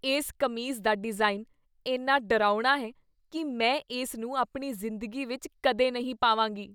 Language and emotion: Punjabi, disgusted